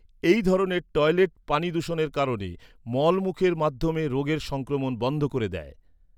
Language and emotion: Bengali, neutral